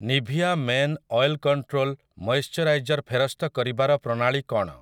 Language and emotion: Odia, neutral